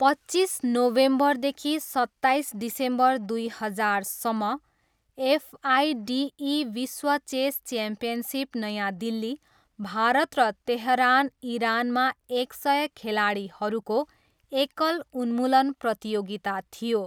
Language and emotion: Nepali, neutral